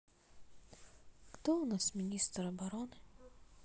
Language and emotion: Russian, sad